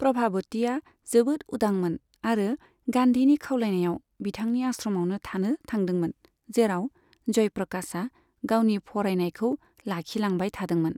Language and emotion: Bodo, neutral